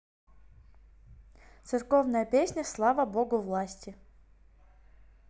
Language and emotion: Russian, neutral